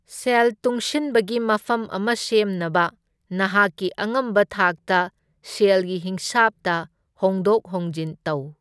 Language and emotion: Manipuri, neutral